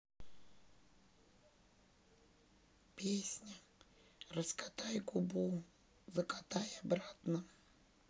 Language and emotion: Russian, sad